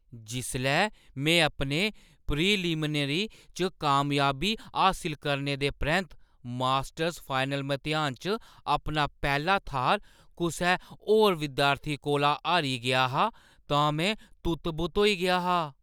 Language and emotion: Dogri, surprised